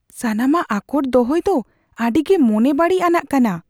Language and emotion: Santali, fearful